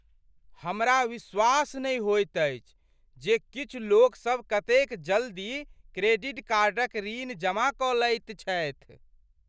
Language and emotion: Maithili, surprised